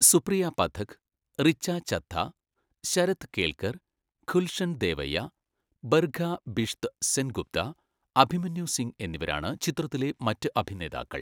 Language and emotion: Malayalam, neutral